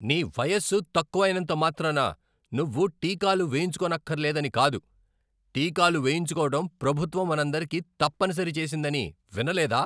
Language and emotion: Telugu, angry